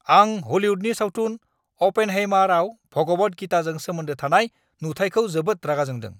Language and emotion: Bodo, angry